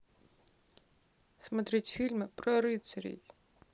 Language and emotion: Russian, sad